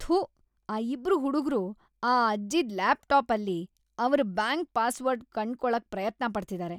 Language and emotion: Kannada, disgusted